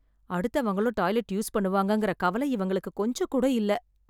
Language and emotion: Tamil, sad